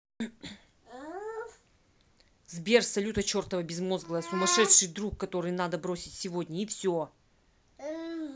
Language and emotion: Russian, angry